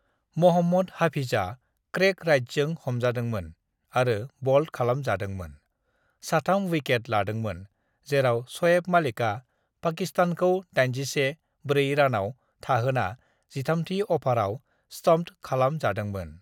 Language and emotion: Bodo, neutral